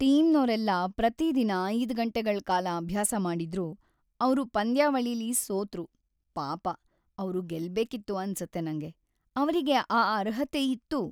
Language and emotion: Kannada, sad